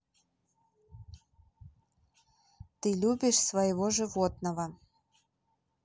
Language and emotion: Russian, neutral